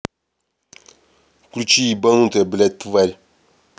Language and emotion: Russian, angry